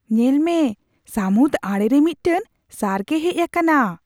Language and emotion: Santali, surprised